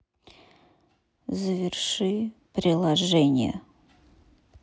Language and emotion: Russian, neutral